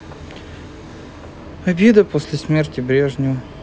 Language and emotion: Russian, sad